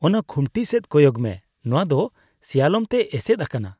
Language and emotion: Santali, disgusted